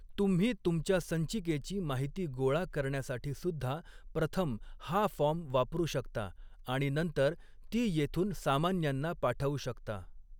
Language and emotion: Marathi, neutral